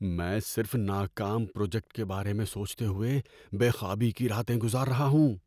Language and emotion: Urdu, fearful